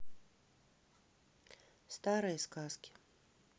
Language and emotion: Russian, neutral